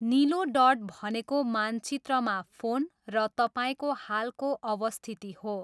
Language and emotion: Nepali, neutral